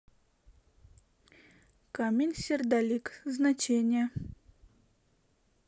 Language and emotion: Russian, neutral